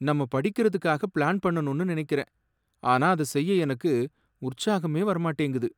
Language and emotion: Tamil, sad